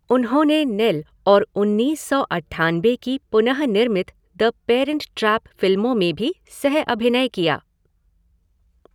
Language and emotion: Hindi, neutral